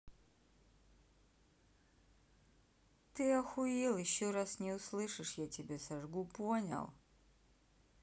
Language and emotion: Russian, neutral